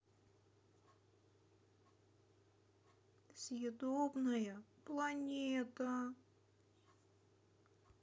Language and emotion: Russian, sad